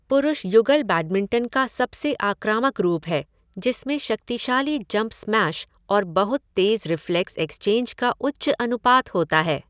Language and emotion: Hindi, neutral